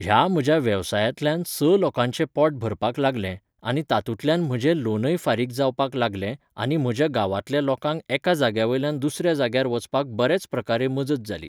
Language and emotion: Goan Konkani, neutral